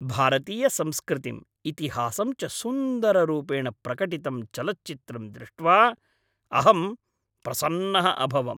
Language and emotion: Sanskrit, happy